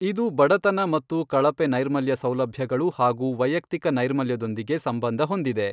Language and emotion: Kannada, neutral